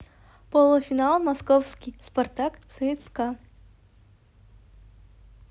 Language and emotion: Russian, neutral